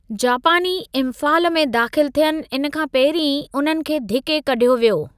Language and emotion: Sindhi, neutral